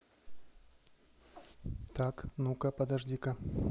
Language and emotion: Russian, neutral